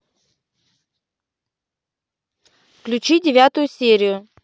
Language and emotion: Russian, neutral